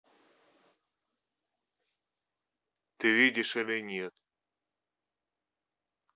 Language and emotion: Russian, neutral